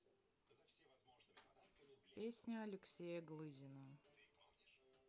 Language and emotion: Russian, neutral